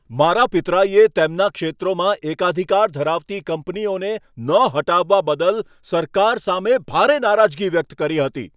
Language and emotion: Gujarati, angry